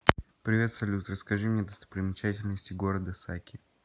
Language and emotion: Russian, neutral